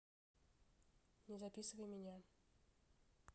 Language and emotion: Russian, neutral